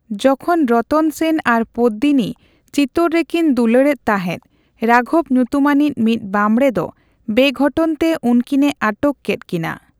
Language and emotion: Santali, neutral